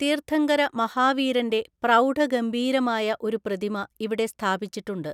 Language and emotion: Malayalam, neutral